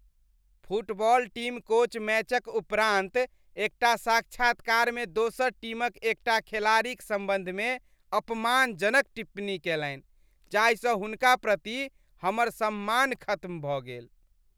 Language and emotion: Maithili, disgusted